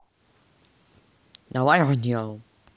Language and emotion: Russian, neutral